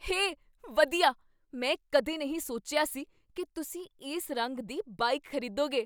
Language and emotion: Punjabi, surprised